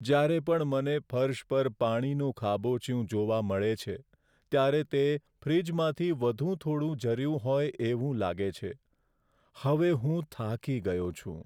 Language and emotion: Gujarati, sad